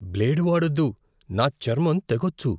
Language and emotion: Telugu, fearful